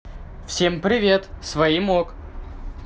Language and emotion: Russian, positive